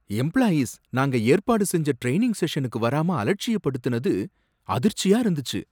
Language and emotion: Tamil, surprised